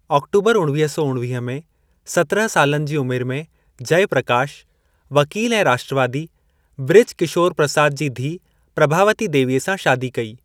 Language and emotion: Sindhi, neutral